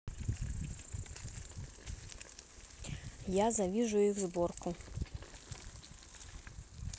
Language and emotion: Russian, neutral